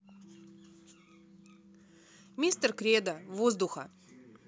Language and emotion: Russian, neutral